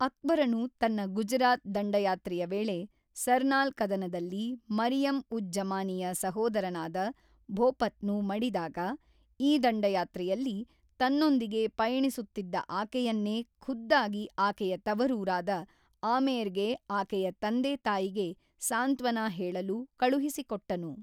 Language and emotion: Kannada, neutral